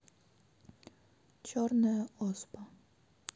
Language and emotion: Russian, neutral